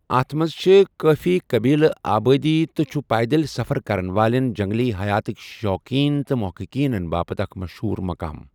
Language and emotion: Kashmiri, neutral